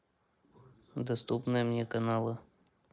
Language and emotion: Russian, neutral